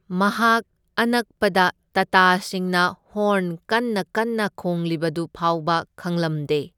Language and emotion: Manipuri, neutral